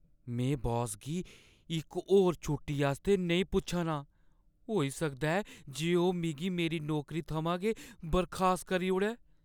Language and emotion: Dogri, fearful